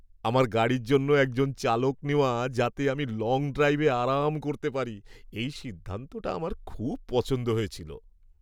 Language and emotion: Bengali, happy